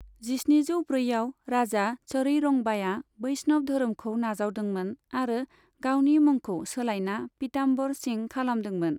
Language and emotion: Bodo, neutral